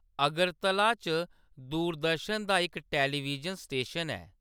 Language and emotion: Dogri, neutral